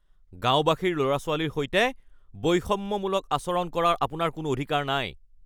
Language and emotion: Assamese, angry